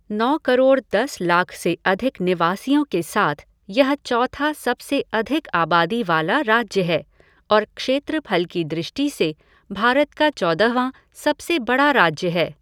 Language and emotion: Hindi, neutral